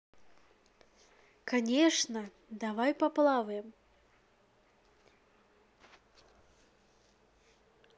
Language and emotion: Russian, positive